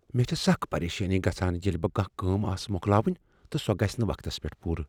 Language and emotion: Kashmiri, fearful